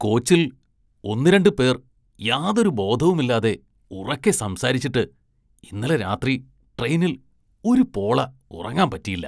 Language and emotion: Malayalam, disgusted